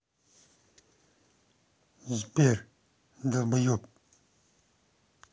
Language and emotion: Russian, angry